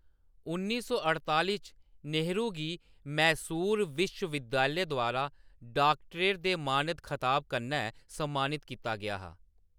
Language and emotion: Dogri, neutral